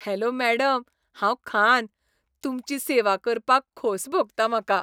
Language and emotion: Goan Konkani, happy